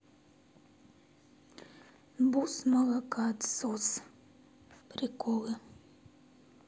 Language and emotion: Russian, sad